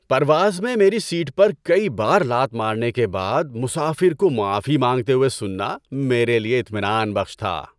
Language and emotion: Urdu, happy